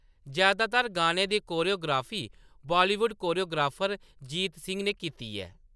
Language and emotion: Dogri, neutral